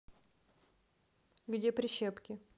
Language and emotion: Russian, neutral